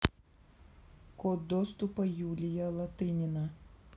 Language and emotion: Russian, neutral